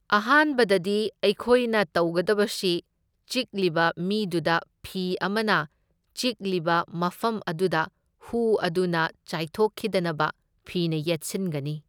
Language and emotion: Manipuri, neutral